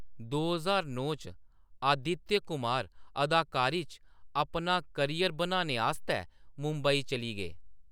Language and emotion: Dogri, neutral